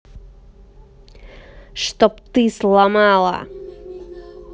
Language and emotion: Russian, angry